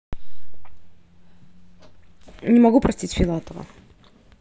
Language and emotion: Russian, neutral